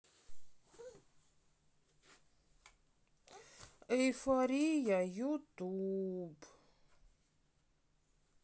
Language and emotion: Russian, sad